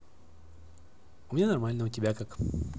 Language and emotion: Russian, positive